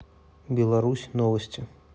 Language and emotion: Russian, neutral